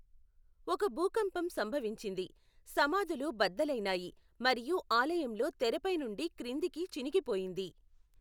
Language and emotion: Telugu, neutral